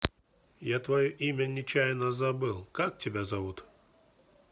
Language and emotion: Russian, neutral